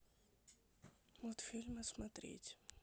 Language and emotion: Russian, neutral